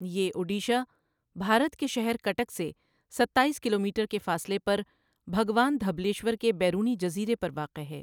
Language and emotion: Urdu, neutral